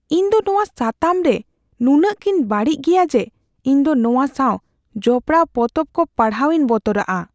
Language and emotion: Santali, fearful